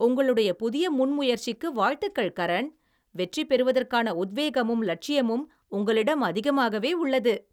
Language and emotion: Tamil, happy